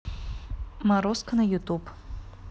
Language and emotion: Russian, neutral